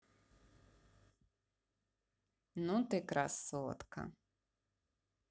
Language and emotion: Russian, positive